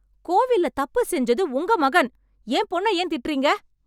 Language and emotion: Tamil, angry